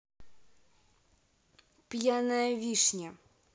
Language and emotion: Russian, neutral